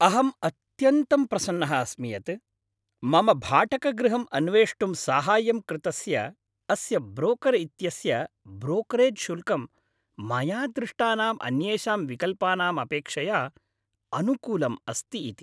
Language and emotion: Sanskrit, happy